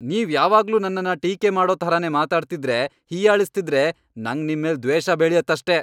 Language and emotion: Kannada, angry